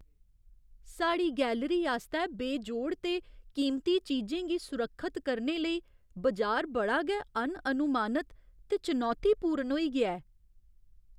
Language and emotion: Dogri, fearful